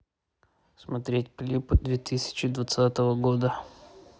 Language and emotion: Russian, neutral